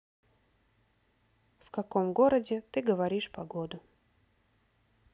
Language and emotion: Russian, neutral